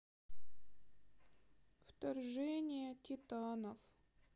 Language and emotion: Russian, sad